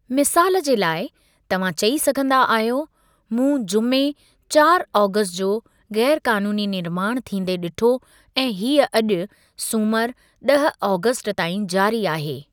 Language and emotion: Sindhi, neutral